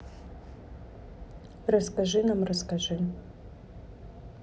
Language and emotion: Russian, neutral